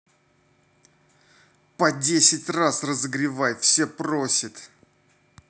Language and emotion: Russian, angry